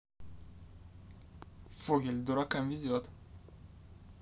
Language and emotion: Russian, neutral